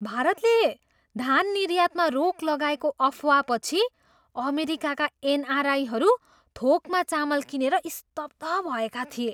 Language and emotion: Nepali, surprised